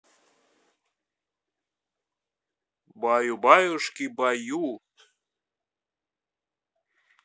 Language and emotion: Russian, neutral